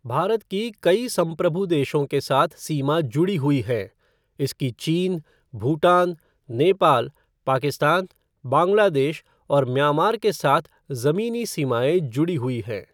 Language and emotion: Hindi, neutral